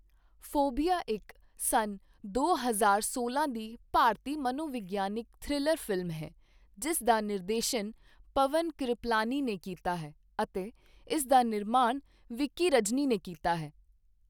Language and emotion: Punjabi, neutral